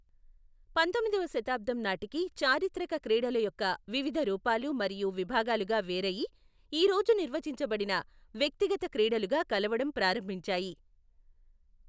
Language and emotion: Telugu, neutral